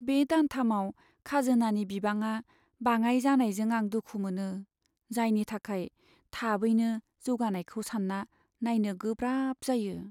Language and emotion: Bodo, sad